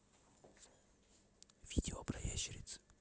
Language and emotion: Russian, neutral